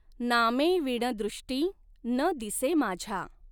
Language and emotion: Marathi, neutral